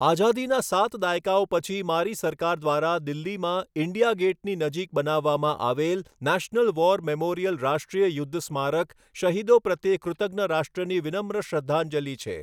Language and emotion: Gujarati, neutral